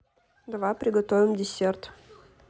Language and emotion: Russian, neutral